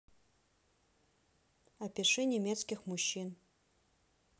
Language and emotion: Russian, neutral